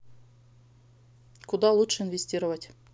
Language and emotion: Russian, neutral